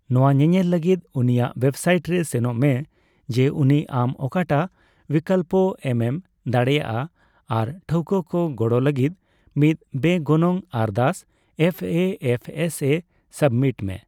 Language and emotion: Santali, neutral